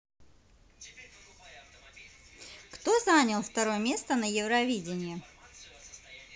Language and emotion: Russian, positive